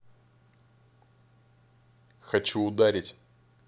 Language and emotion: Russian, angry